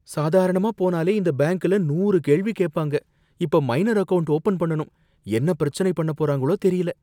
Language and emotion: Tamil, fearful